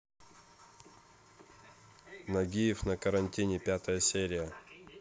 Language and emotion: Russian, neutral